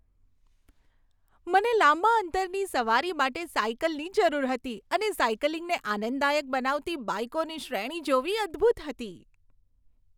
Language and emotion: Gujarati, happy